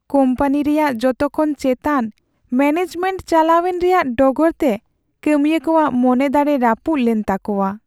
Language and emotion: Santali, sad